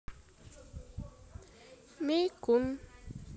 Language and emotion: Russian, neutral